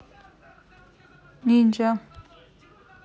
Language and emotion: Russian, neutral